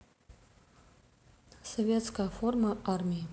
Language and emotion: Russian, neutral